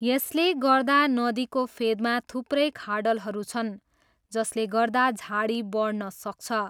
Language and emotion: Nepali, neutral